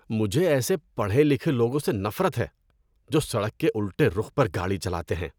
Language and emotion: Urdu, disgusted